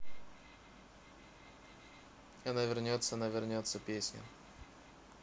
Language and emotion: Russian, neutral